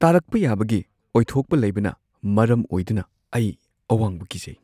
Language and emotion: Manipuri, fearful